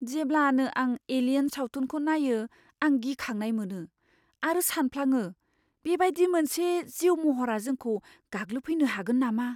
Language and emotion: Bodo, fearful